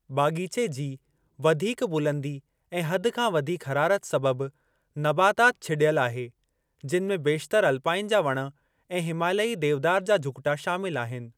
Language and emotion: Sindhi, neutral